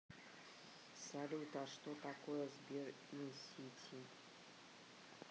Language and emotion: Russian, neutral